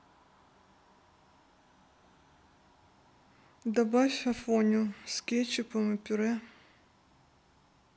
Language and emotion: Russian, neutral